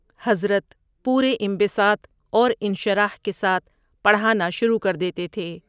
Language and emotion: Urdu, neutral